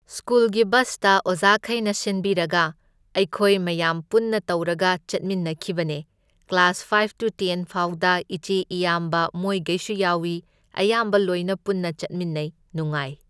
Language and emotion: Manipuri, neutral